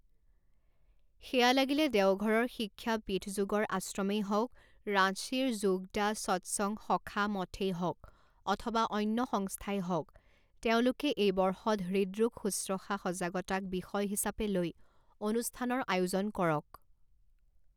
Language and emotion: Assamese, neutral